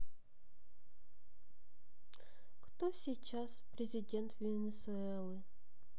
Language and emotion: Russian, sad